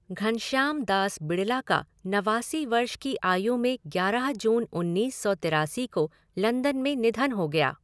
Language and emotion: Hindi, neutral